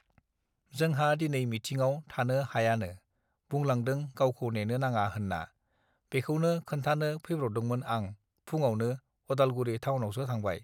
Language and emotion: Bodo, neutral